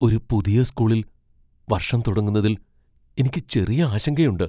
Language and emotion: Malayalam, fearful